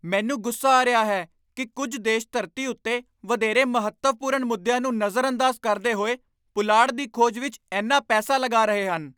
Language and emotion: Punjabi, angry